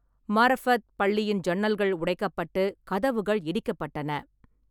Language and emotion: Tamil, neutral